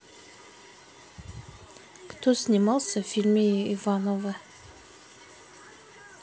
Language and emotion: Russian, neutral